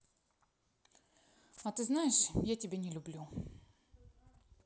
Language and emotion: Russian, neutral